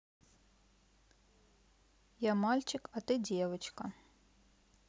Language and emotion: Russian, neutral